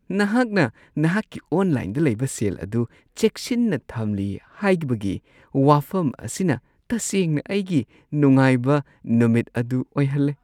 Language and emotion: Manipuri, happy